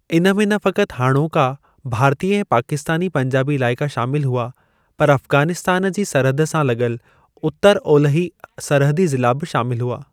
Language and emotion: Sindhi, neutral